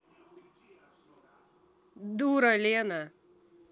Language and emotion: Russian, angry